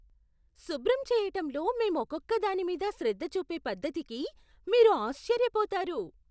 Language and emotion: Telugu, surprised